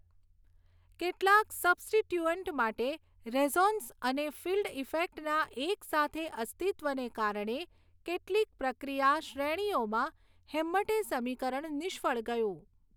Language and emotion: Gujarati, neutral